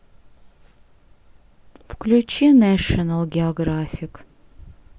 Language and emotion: Russian, sad